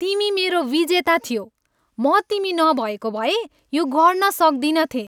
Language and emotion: Nepali, happy